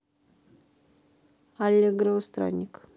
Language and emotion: Russian, neutral